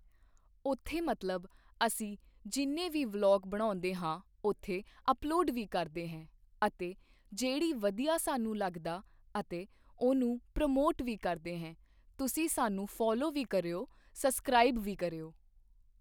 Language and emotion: Punjabi, neutral